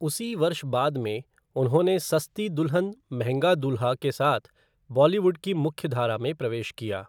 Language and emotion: Hindi, neutral